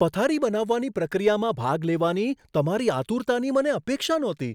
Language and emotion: Gujarati, surprised